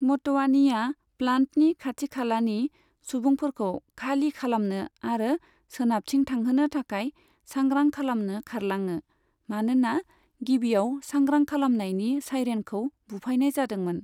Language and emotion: Bodo, neutral